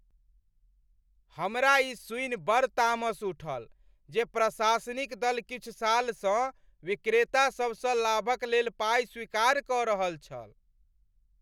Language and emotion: Maithili, angry